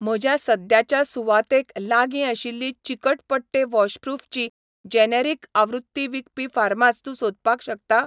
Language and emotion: Goan Konkani, neutral